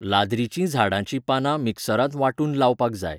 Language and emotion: Goan Konkani, neutral